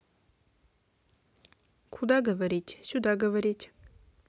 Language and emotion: Russian, neutral